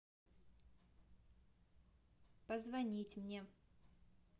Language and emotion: Russian, neutral